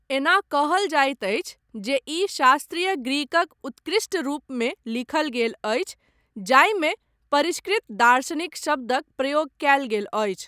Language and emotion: Maithili, neutral